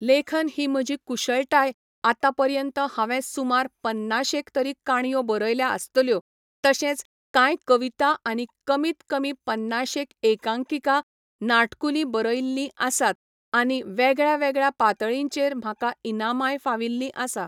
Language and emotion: Goan Konkani, neutral